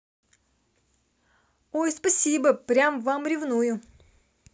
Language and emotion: Russian, positive